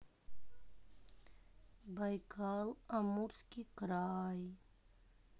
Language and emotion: Russian, sad